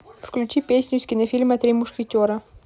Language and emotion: Russian, neutral